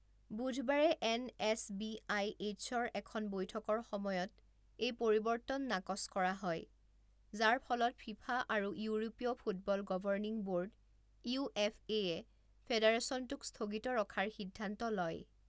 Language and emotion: Assamese, neutral